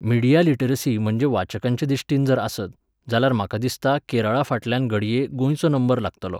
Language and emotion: Goan Konkani, neutral